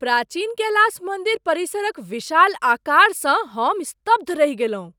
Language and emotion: Maithili, surprised